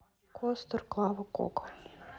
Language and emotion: Russian, neutral